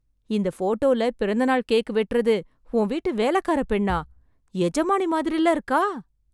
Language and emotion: Tamil, surprised